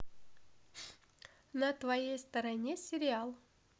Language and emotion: Russian, positive